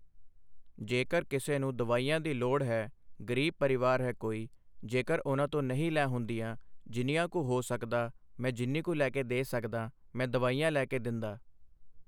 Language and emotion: Punjabi, neutral